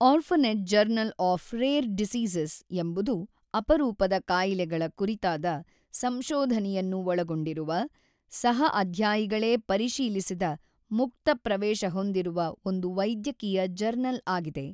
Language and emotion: Kannada, neutral